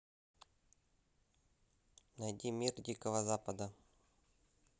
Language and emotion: Russian, neutral